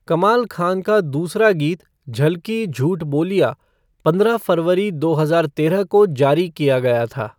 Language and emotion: Hindi, neutral